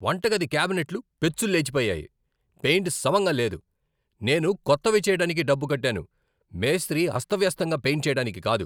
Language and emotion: Telugu, angry